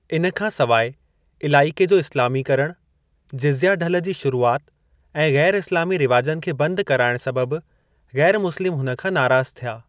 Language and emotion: Sindhi, neutral